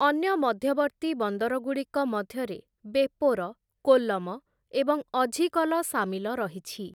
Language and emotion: Odia, neutral